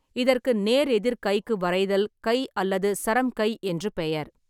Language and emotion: Tamil, neutral